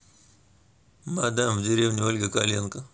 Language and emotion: Russian, neutral